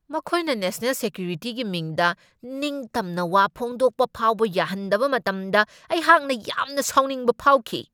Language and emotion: Manipuri, angry